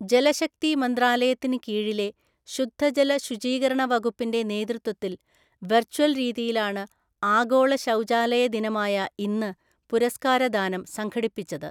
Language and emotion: Malayalam, neutral